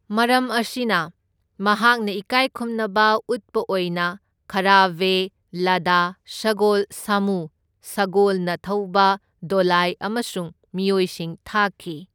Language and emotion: Manipuri, neutral